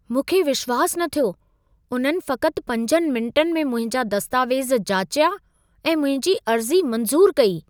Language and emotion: Sindhi, surprised